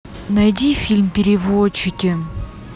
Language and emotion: Russian, neutral